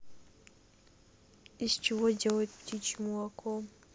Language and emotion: Russian, neutral